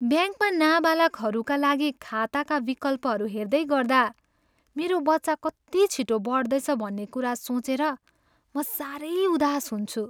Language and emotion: Nepali, sad